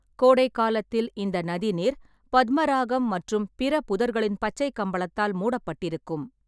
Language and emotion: Tamil, neutral